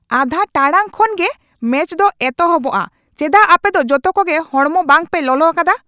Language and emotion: Santali, angry